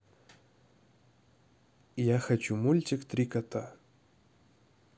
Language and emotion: Russian, neutral